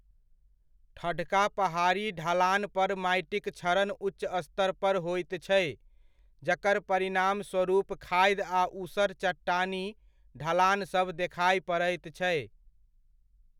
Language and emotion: Maithili, neutral